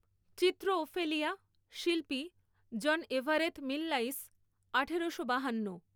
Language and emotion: Bengali, neutral